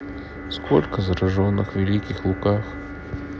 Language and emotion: Russian, sad